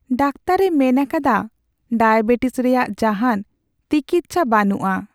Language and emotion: Santali, sad